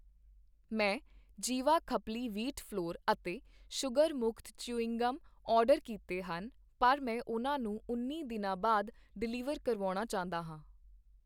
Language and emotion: Punjabi, neutral